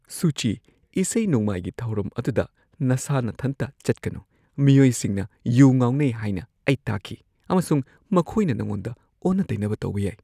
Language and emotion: Manipuri, fearful